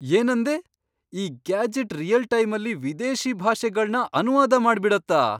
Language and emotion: Kannada, surprised